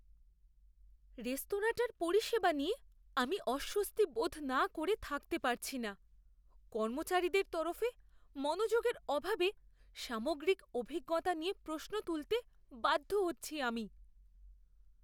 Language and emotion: Bengali, fearful